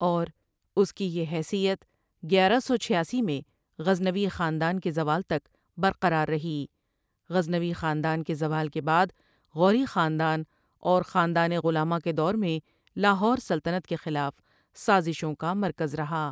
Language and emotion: Urdu, neutral